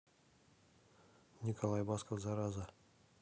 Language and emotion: Russian, neutral